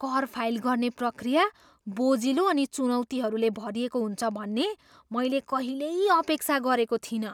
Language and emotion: Nepali, surprised